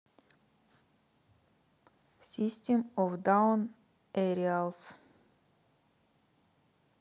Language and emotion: Russian, neutral